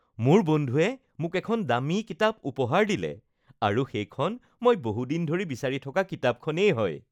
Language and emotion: Assamese, happy